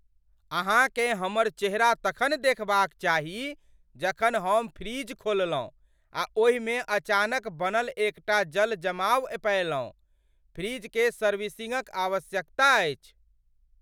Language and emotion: Maithili, surprised